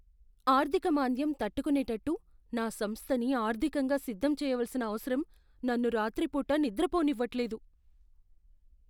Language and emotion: Telugu, fearful